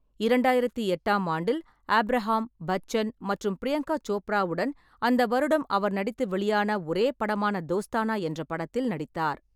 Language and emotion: Tamil, neutral